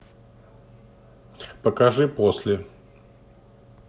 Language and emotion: Russian, neutral